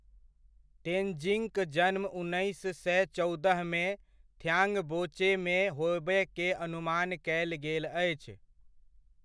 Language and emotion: Maithili, neutral